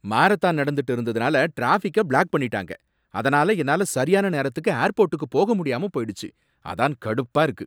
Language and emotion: Tamil, angry